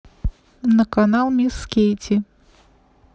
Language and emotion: Russian, neutral